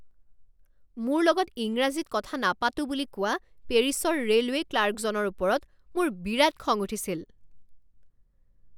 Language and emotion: Assamese, angry